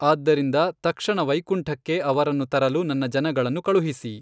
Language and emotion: Kannada, neutral